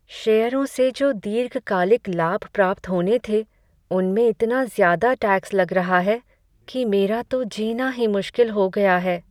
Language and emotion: Hindi, sad